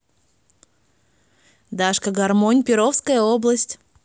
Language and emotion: Russian, positive